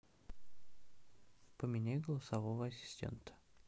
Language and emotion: Russian, neutral